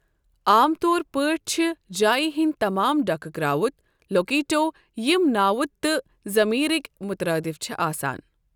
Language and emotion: Kashmiri, neutral